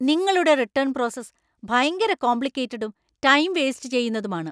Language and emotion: Malayalam, angry